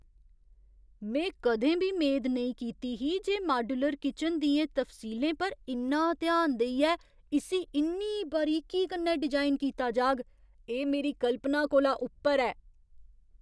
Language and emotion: Dogri, surprised